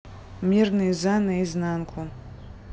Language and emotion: Russian, neutral